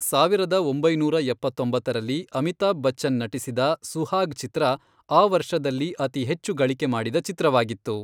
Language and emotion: Kannada, neutral